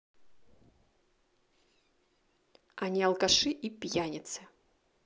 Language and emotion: Russian, angry